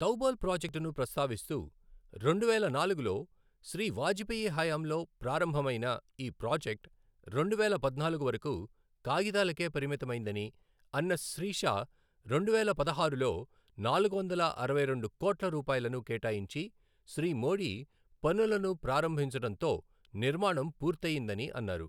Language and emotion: Telugu, neutral